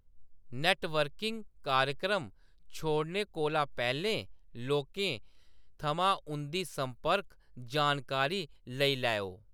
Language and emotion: Dogri, neutral